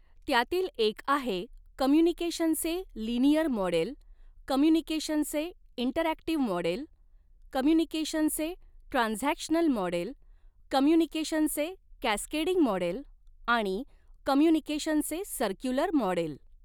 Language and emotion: Marathi, neutral